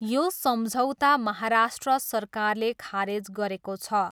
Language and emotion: Nepali, neutral